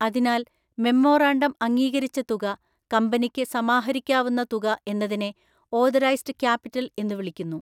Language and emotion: Malayalam, neutral